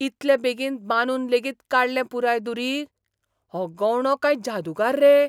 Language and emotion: Goan Konkani, surprised